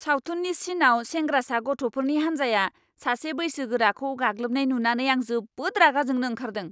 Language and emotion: Bodo, angry